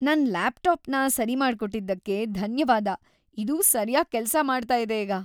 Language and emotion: Kannada, happy